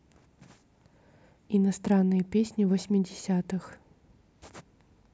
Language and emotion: Russian, neutral